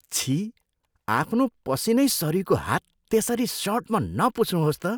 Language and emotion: Nepali, disgusted